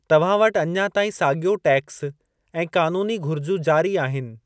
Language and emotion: Sindhi, neutral